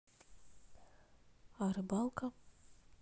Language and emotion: Russian, neutral